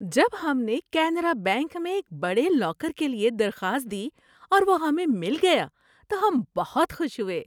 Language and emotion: Urdu, happy